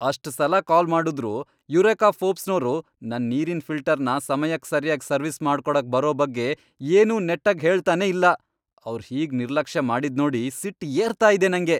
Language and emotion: Kannada, angry